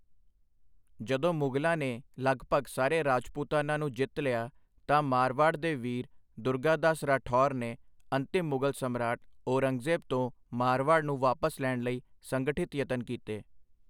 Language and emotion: Punjabi, neutral